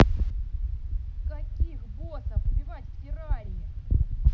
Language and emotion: Russian, angry